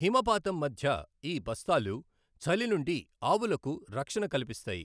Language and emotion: Telugu, neutral